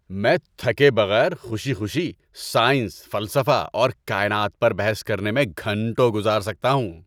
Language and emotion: Urdu, happy